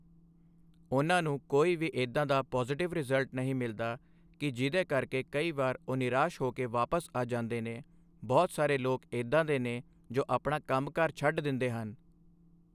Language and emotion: Punjabi, neutral